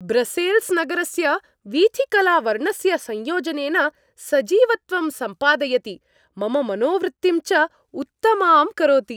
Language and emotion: Sanskrit, happy